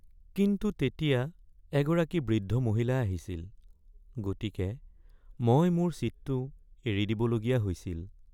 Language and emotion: Assamese, sad